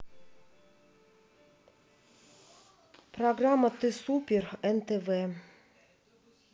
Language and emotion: Russian, neutral